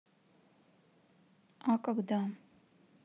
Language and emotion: Russian, sad